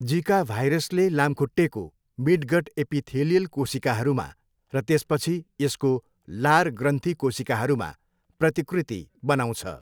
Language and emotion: Nepali, neutral